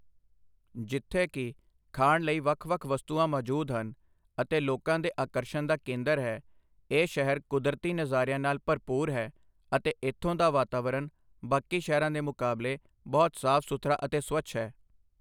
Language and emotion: Punjabi, neutral